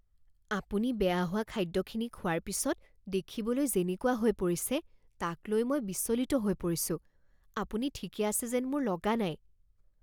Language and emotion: Assamese, fearful